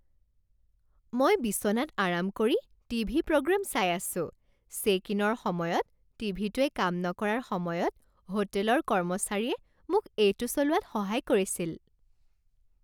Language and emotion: Assamese, happy